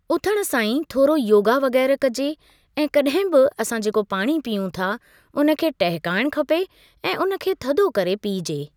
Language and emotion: Sindhi, neutral